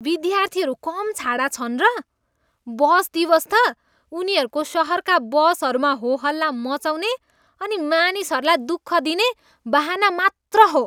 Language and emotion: Nepali, disgusted